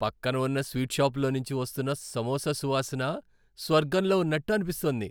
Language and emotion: Telugu, happy